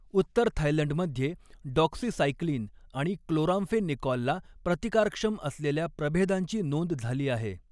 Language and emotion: Marathi, neutral